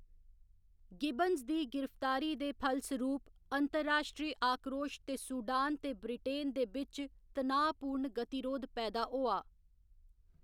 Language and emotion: Dogri, neutral